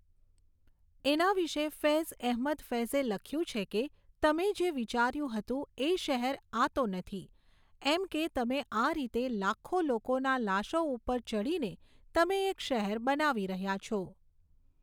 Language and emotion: Gujarati, neutral